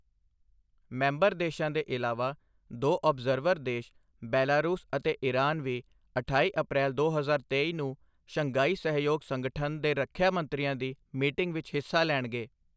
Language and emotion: Punjabi, neutral